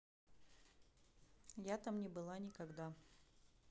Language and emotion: Russian, neutral